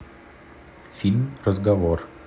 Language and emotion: Russian, neutral